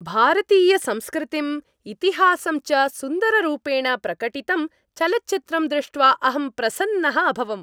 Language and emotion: Sanskrit, happy